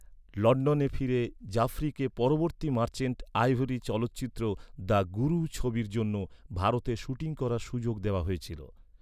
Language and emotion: Bengali, neutral